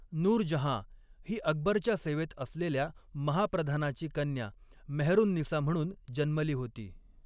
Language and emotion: Marathi, neutral